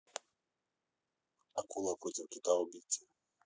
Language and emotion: Russian, neutral